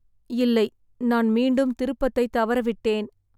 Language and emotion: Tamil, sad